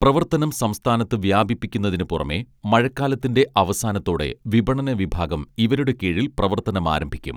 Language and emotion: Malayalam, neutral